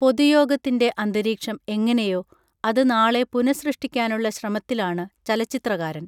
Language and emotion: Malayalam, neutral